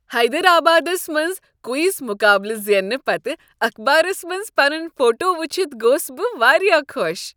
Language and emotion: Kashmiri, happy